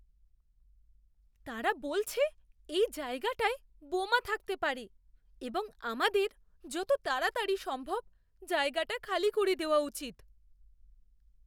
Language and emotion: Bengali, fearful